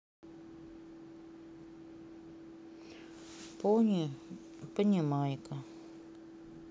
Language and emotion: Russian, sad